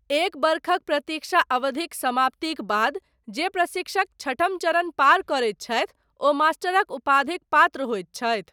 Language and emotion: Maithili, neutral